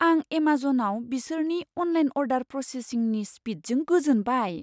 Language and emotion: Bodo, surprised